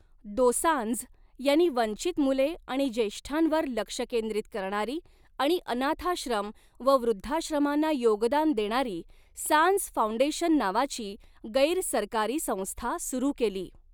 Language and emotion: Marathi, neutral